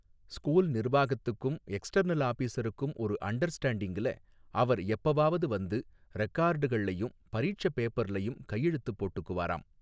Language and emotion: Tamil, neutral